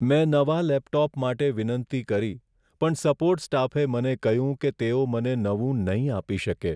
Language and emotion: Gujarati, sad